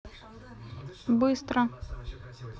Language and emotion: Russian, neutral